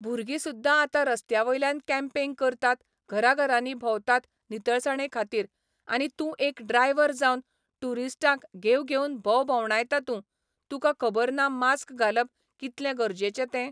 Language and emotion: Goan Konkani, neutral